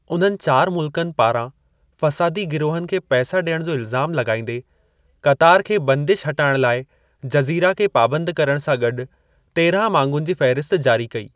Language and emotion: Sindhi, neutral